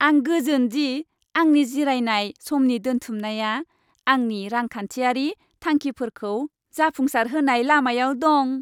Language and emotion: Bodo, happy